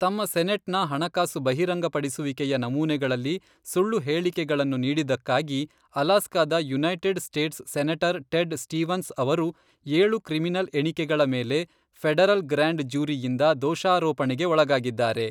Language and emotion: Kannada, neutral